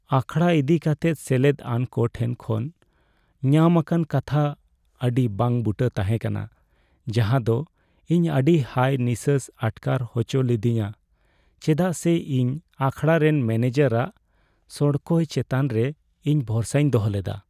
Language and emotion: Santali, sad